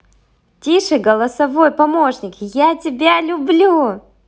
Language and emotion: Russian, positive